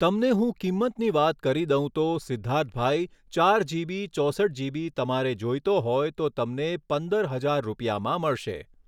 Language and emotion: Gujarati, neutral